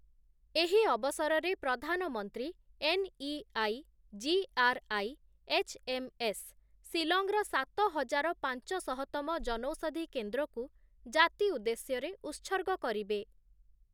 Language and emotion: Odia, neutral